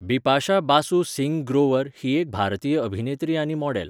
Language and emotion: Goan Konkani, neutral